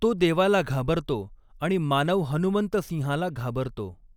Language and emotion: Marathi, neutral